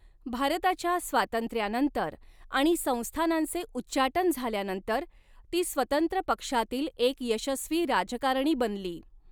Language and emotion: Marathi, neutral